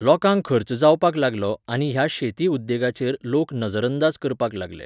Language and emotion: Goan Konkani, neutral